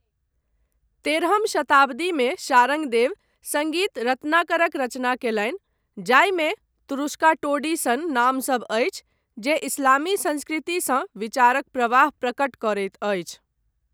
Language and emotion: Maithili, neutral